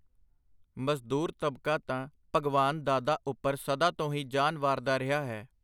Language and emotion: Punjabi, neutral